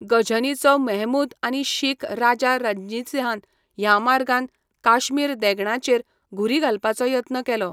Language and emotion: Goan Konkani, neutral